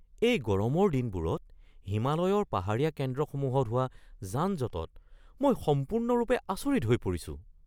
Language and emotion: Assamese, surprised